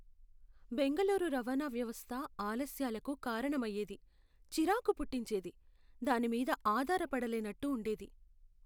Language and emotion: Telugu, sad